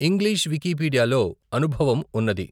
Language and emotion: Telugu, neutral